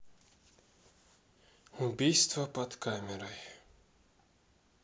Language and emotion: Russian, sad